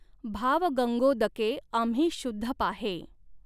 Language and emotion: Marathi, neutral